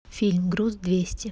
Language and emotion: Russian, neutral